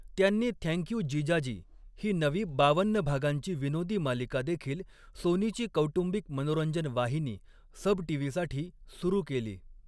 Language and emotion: Marathi, neutral